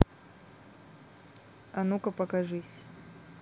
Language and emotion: Russian, neutral